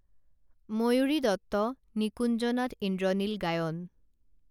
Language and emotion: Assamese, neutral